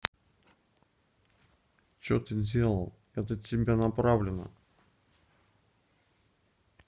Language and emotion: Russian, neutral